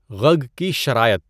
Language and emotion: Urdu, neutral